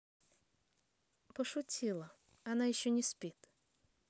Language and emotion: Russian, neutral